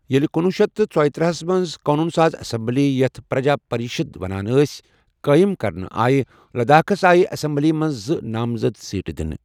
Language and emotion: Kashmiri, neutral